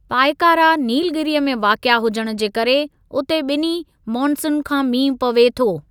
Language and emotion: Sindhi, neutral